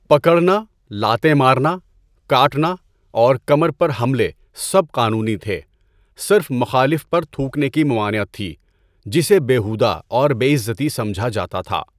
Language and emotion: Urdu, neutral